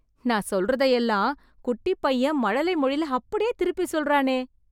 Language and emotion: Tamil, surprised